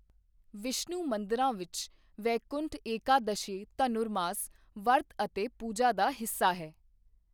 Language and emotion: Punjabi, neutral